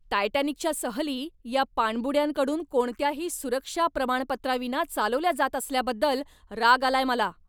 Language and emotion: Marathi, angry